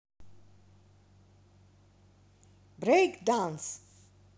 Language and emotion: Russian, positive